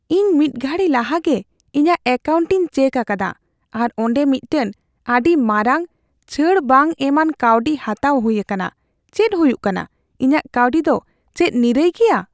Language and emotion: Santali, fearful